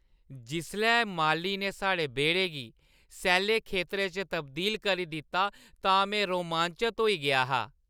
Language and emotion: Dogri, happy